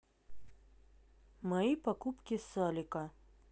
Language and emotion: Russian, neutral